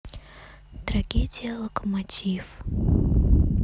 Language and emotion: Russian, neutral